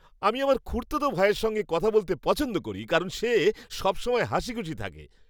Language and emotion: Bengali, happy